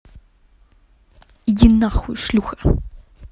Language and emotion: Russian, angry